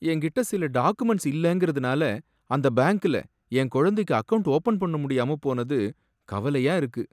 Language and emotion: Tamil, sad